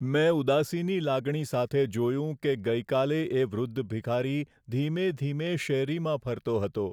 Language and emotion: Gujarati, sad